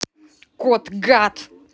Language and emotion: Russian, angry